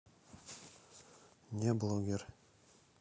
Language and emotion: Russian, neutral